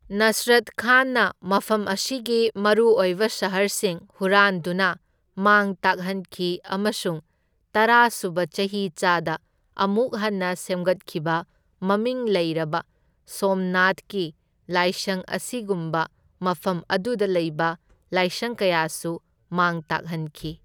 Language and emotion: Manipuri, neutral